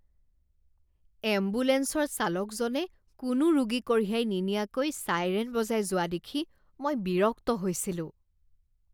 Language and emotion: Assamese, disgusted